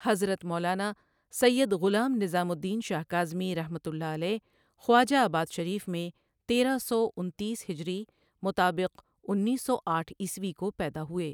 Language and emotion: Urdu, neutral